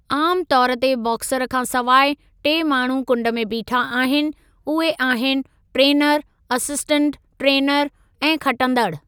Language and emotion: Sindhi, neutral